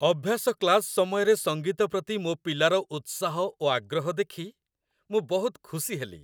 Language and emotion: Odia, happy